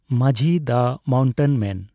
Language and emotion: Santali, neutral